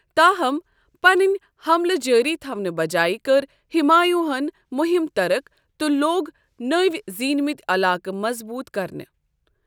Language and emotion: Kashmiri, neutral